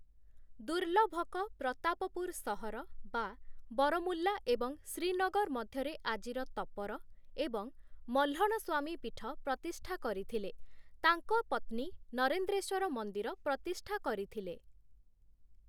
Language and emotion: Odia, neutral